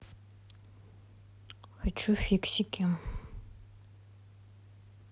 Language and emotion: Russian, neutral